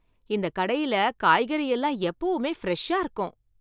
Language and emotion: Tamil, happy